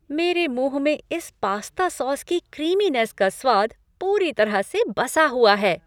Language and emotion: Hindi, happy